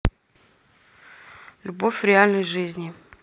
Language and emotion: Russian, neutral